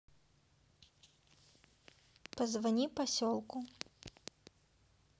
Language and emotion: Russian, neutral